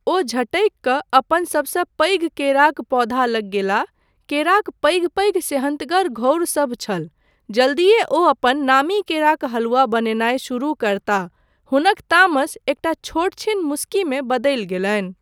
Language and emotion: Maithili, neutral